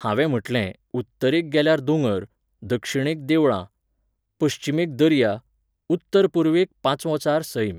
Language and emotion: Goan Konkani, neutral